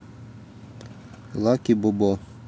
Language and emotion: Russian, neutral